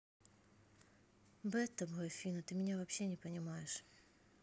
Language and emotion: Russian, neutral